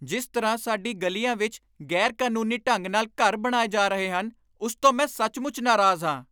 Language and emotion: Punjabi, angry